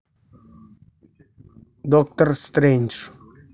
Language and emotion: Russian, neutral